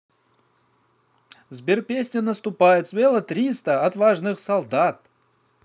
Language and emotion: Russian, positive